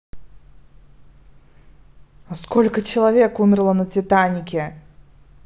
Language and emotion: Russian, angry